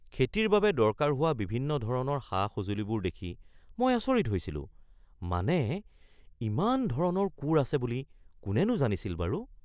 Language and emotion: Assamese, surprised